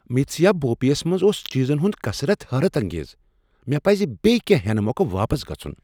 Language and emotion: Kashmiri, surprised